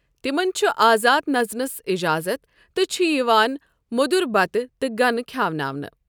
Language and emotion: Kashmiri, neutral